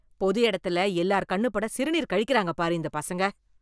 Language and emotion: Tamil, disgusted